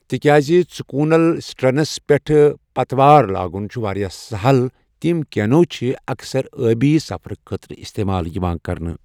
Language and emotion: Kashmiri, neutral